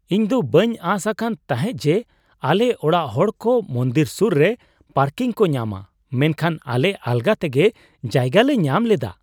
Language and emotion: Santali, surprised